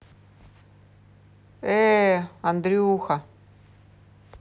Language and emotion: Russian, neutral